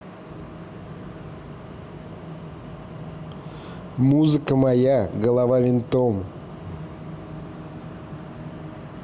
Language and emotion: Russian, neutral